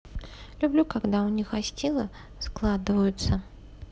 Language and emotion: Russian, neutral